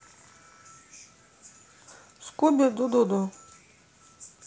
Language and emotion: Russian, neutral